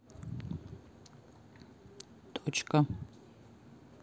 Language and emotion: Russian, neutral